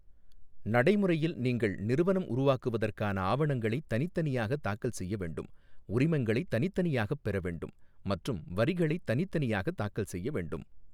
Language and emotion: Tamil, neutral